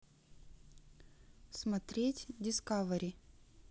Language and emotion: Russian, neutral